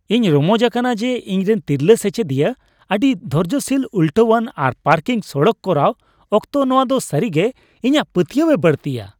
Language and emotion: Santali, happy